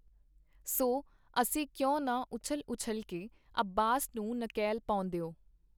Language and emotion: Punjabi, neutral